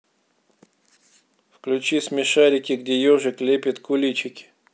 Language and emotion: Russian, neutral